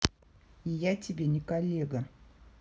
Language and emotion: Russian, angry